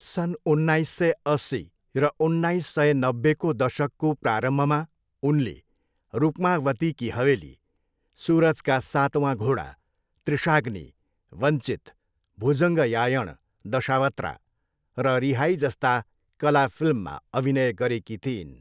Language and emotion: Nepali, neutral